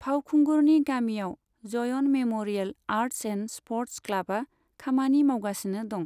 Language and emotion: Bodo, neutral